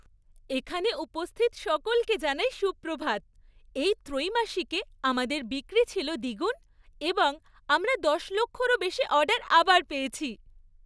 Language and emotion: Bengali, happy